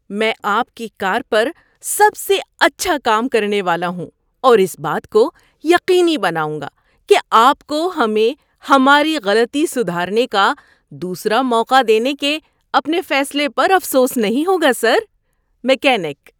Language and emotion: Urdu, happy